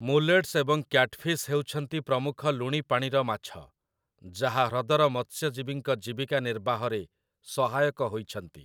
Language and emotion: Odia, neutral